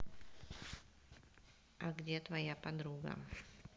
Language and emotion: Russian, neutral